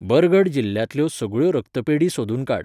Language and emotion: Goan Konkani, neutral